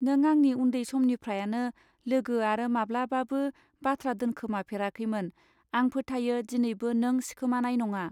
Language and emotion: Bodo, neutral